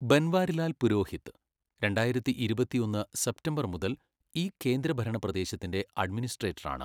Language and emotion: Malayalam, neutral